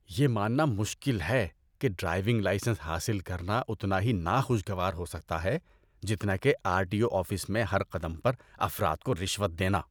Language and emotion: Urdu, disgusted